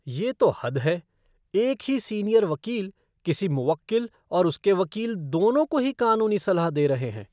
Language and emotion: Hindi, disgusted